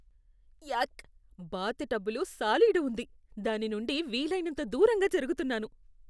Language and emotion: Telugu, disgusted